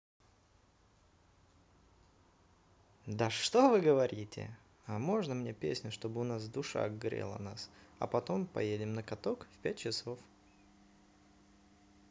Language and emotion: Russian, positive